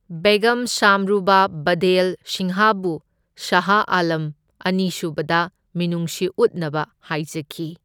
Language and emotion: Manipuri, neutral